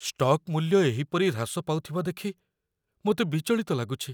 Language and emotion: Odia, fearful